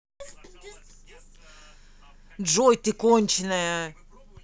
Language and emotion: Russian, angry